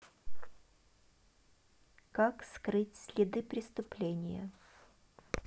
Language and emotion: Russian, neutral